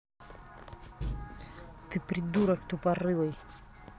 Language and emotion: Russian, angry